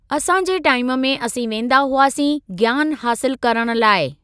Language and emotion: Sindhi, neutral